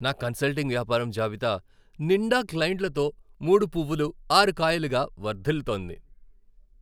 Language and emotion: Telugu, happy